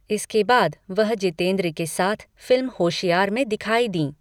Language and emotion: Hindi, neutral